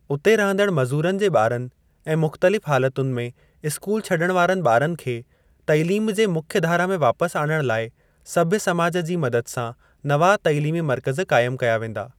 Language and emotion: Sindhi, neutral